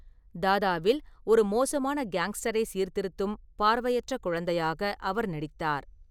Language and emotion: Tamil, neutral